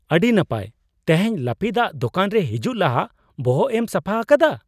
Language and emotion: Santali, surprised